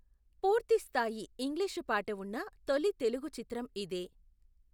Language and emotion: Telugu, neutral